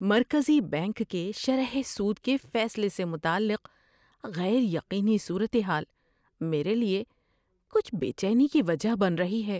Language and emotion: Urdu, fearful